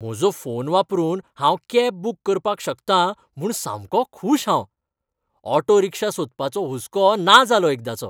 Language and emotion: Goan Konkani, happy